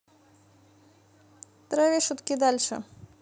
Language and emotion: Russian, neutral